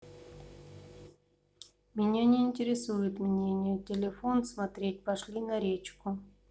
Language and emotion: Russian, neutral